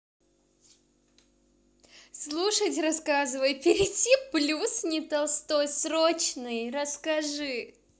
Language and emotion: Russian, positive